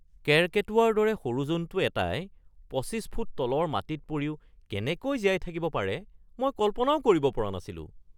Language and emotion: Assamese, surprised